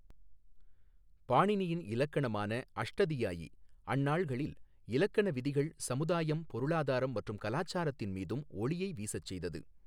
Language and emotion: Tamil, neutral